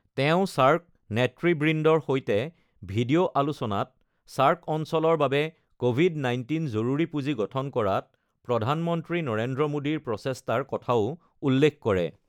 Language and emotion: Assamese, neutral